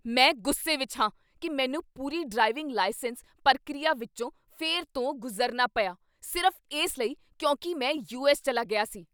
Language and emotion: Punjabi, angry